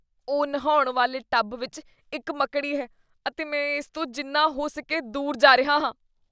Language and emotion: Punjabi, disgusted